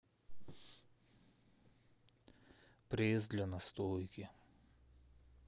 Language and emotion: Russian, sad